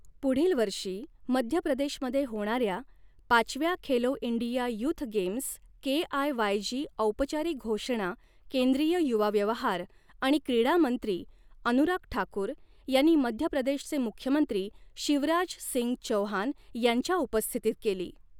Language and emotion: Marathi, neutral